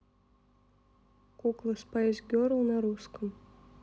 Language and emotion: Russian, neutral